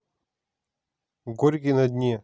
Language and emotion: Russian, neutral